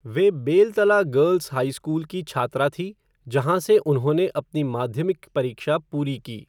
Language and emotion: Hindi, neutral